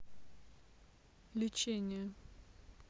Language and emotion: Russian, neutral